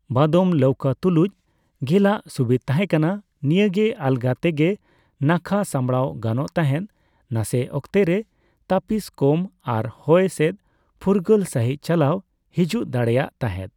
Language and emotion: Santali, neutral